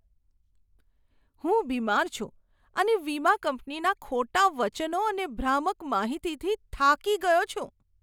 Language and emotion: Gujarati, disgusted